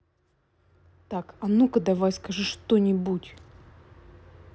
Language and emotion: Russian, angry